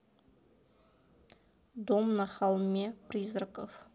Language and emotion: Russian, neutral